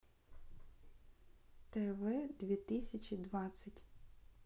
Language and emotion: Russian, neutral